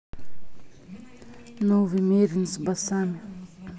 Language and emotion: Russian, neutral